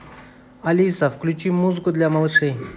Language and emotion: Russian, neutral